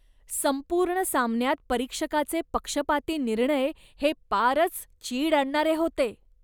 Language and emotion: Marathi, disgusted